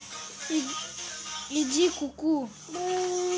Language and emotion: Russian, neutral